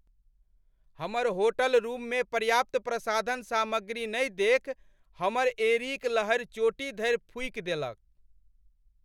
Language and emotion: Maithili, angry